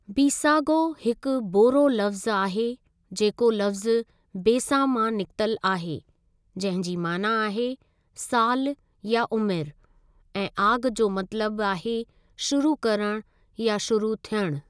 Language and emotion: Sindhi, neutral